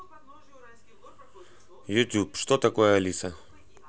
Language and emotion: Russian, neutral